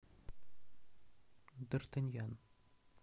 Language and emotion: Russian, neutral